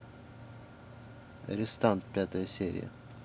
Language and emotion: Russian, neutral